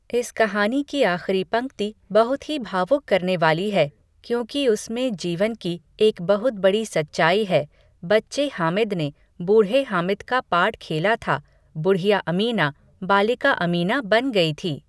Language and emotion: Hindi, neutral